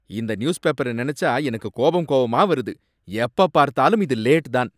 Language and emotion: Tamil, angry